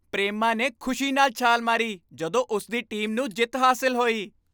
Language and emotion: Punjabi, happy